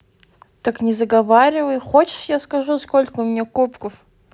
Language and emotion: Russian, neutral